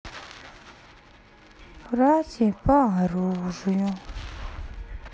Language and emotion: Russian, sad